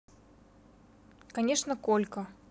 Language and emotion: Russian, neutral